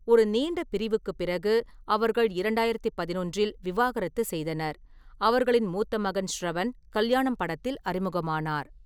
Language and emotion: Tamil, neutral